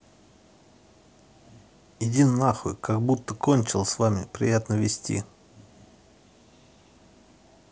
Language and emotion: Russian, angry